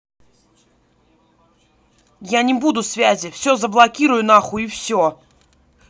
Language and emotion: Russian, angry